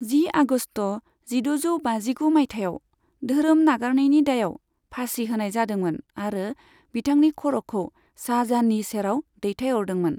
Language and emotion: Bodo, neutral